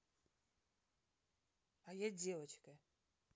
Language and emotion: Russian, neutral